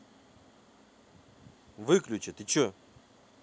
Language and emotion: Russian, angry